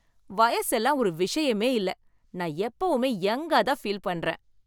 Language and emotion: Tamil, happy